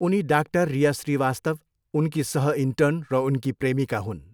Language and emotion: Nepali, neutral